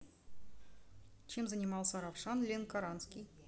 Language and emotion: Russian, neutral